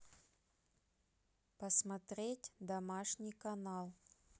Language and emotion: Russian, neutral